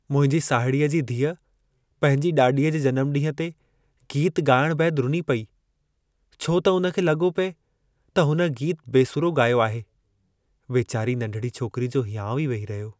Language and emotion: Sindhi, sad